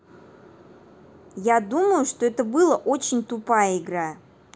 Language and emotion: Russian, angry